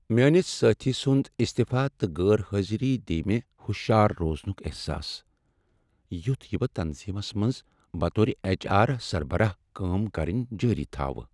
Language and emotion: Kashmiri, sad